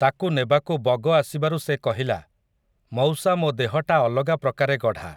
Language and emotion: Odia, neutral